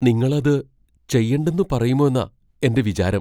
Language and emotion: Malayalam, fearful